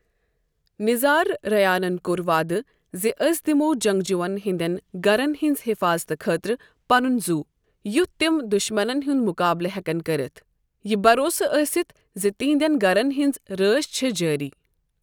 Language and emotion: Kashmiri, neutral